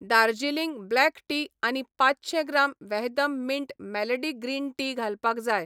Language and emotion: Goan Konkani, neutral